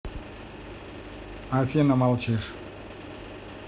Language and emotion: Russian, neutral